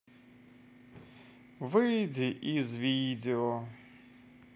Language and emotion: Russian, positive